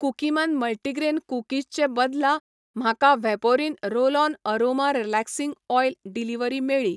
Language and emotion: Goan Konkani, neutral